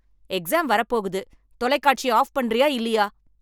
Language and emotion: Tamil, angry